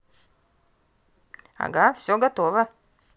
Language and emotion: Russian, positive